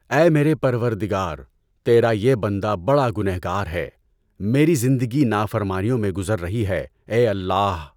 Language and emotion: Urdu, neutral